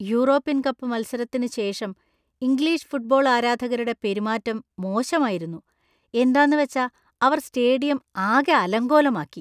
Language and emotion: Malayalam, disgusted